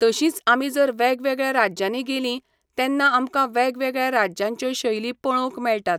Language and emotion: Goan Konkani, neutral